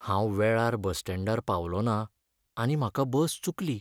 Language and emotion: Goan Konkani, sad